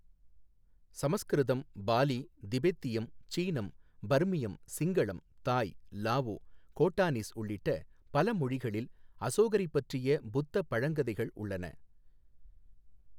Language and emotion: Tamil, neutral